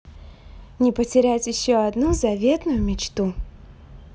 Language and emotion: Russian, positive